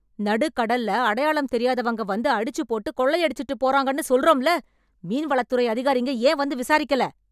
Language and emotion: Tamil, angry